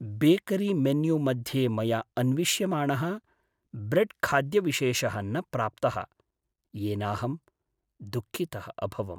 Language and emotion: Sanskrit, sad